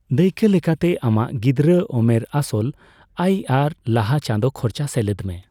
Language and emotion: Santali, neutral